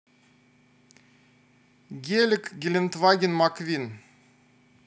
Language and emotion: Russian, neutral